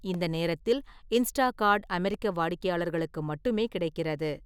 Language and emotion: Tamil, neutral